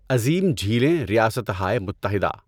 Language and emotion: Urdu, neutral